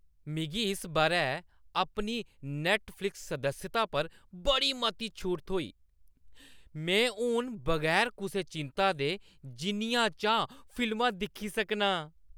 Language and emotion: Dogri, happy